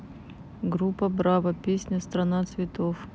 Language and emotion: Russian, neutral